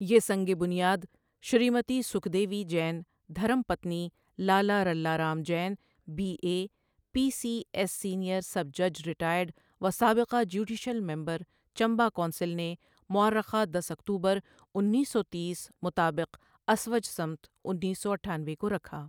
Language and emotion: Urdu, neutral